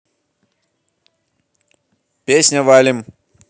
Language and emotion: Russian, positive